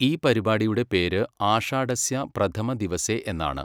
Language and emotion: Malayalam, neutral